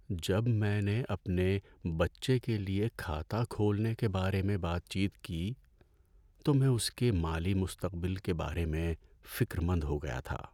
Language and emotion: Urdu, sad